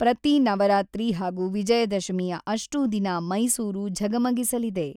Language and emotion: Kannada, neutral